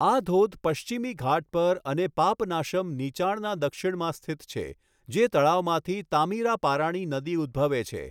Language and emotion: Gujarati, neutral